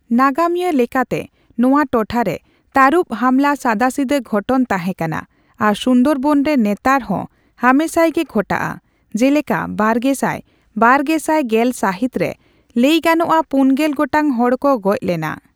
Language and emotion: Santali, neutral